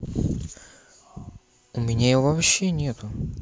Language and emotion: Russian, neutral